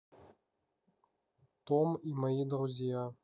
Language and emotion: Russian, neutral